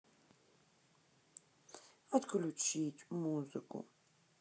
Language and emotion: Russian, sad